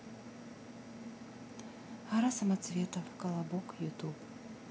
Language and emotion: Russian, sad